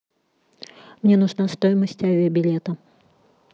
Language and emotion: Russian, neutral